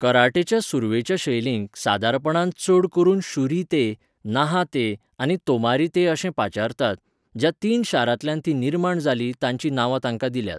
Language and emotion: Goan Konkani, neutral